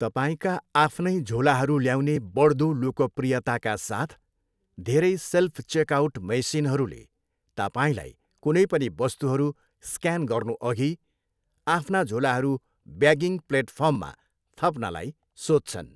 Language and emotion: Nepali, neutral